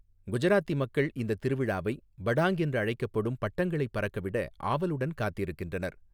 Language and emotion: Tamil, neutral